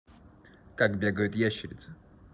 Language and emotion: Russian, neutral